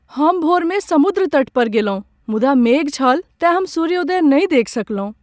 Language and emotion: Maithili, sad